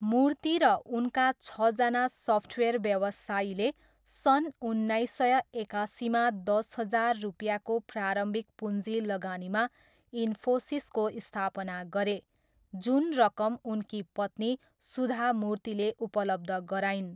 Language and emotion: Nepali, neutral